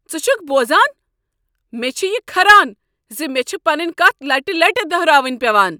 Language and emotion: Kashmiri, angry